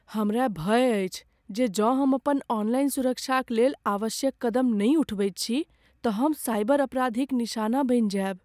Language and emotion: Maithili, fearful